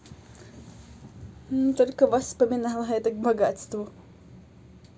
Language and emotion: Russian, positive